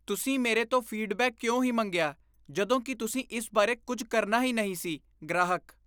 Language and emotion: Punjabi, disgusted